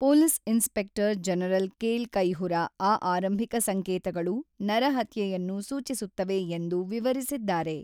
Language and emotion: Kannada, neutral